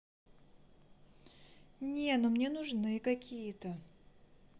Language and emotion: Russian, neutral